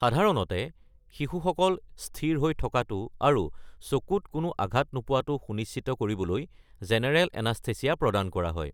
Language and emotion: Assamese, neutral